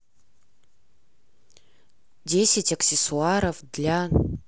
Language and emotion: Russian, neutral